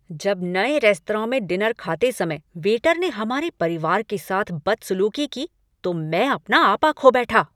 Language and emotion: Hindi, angry